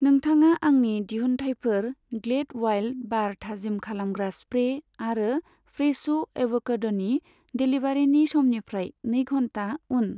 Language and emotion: Bodo, neutral